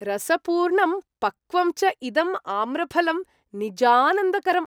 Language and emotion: Sanskrit, happy